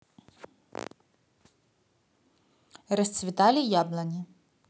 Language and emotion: Russian, positive